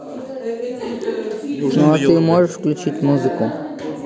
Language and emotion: Russian, neutral